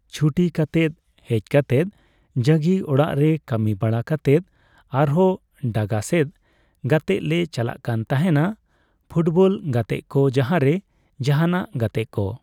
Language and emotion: Santali, neutral